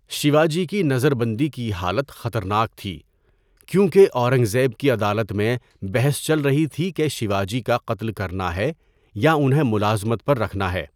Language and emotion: Urdu, neutral